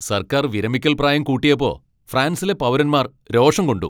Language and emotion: Malayalam, angry